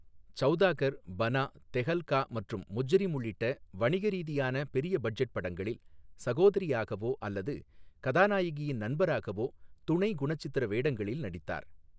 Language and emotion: Tamil, neutral